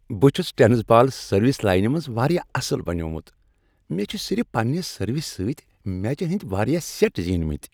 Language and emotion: Kashmiri, happy